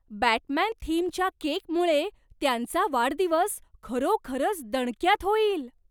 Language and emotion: Marathi, surprised